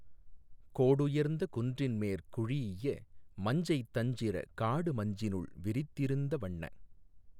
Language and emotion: Tamil, neutral